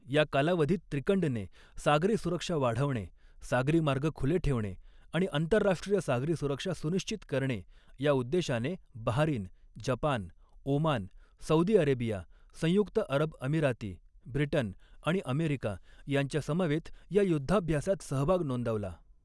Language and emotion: Marathi, neutral